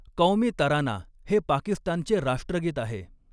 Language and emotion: Marathi, neutral